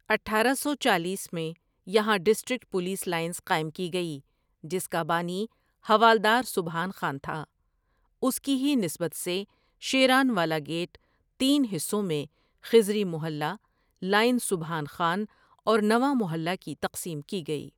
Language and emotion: Urdu, neutral